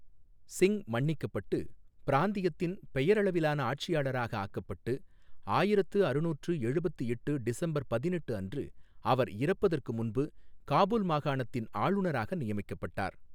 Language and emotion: Tamil, neutral